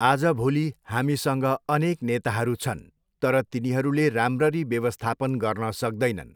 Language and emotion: Nepali, neutral